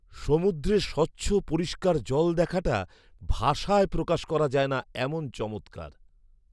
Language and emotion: Bengali, surprised